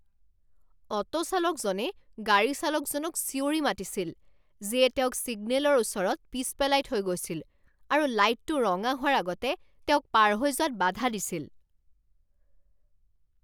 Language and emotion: Assamese, angry